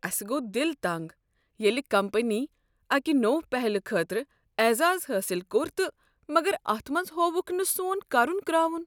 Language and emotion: Kashmiri, sad